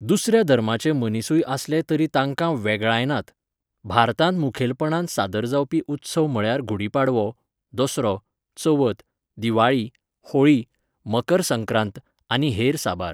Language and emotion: Goan Konkani, neutral